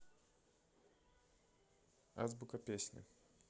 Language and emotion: Russian, neutral